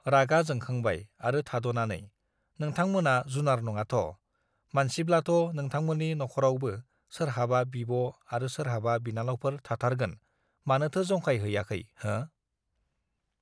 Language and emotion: Bodo, neutral